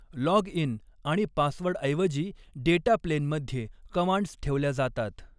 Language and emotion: Marathi, neutral